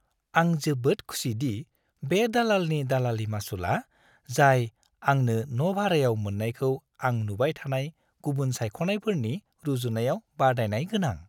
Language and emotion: Bodo, happy